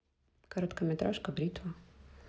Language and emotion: Russian, neutral